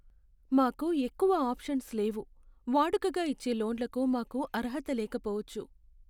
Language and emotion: Telugu, sad